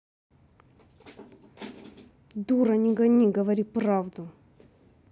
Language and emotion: Russian, angry